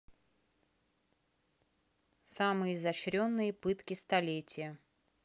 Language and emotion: Russian, neutral